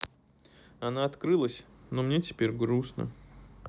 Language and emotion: Russian, sad